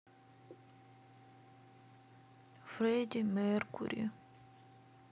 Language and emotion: Russian, sad